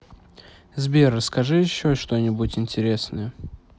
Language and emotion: Russian, neutral